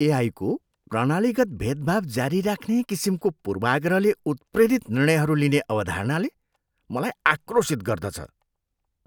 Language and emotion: Nepali, disgusted